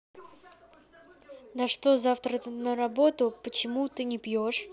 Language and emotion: Russian, neutral